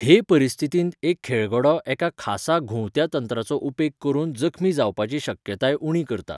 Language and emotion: Goan Konkani, neutral